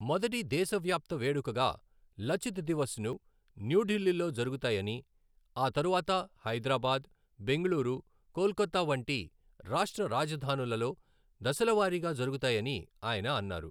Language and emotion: Telugu, neutral